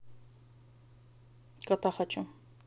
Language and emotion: Russian, neutral